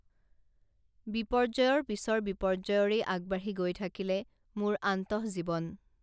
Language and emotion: Assamese, neutral